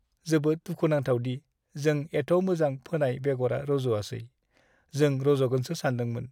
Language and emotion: Bodo, sad